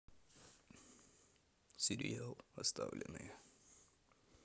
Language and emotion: Russian, neutral